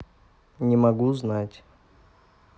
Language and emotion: Russian, neutral